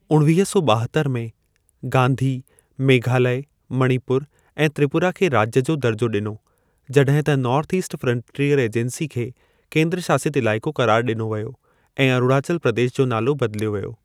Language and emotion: Sindhi, neutral